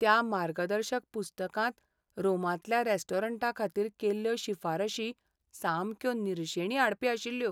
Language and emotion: Goan Konkani, sad